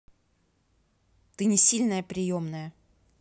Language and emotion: Russian, angry